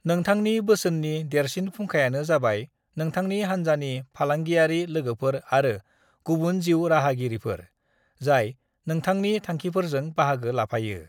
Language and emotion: Bodo, neutral